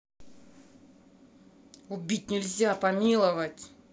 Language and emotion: Russian, angry